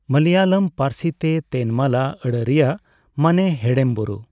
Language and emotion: Santali, neutral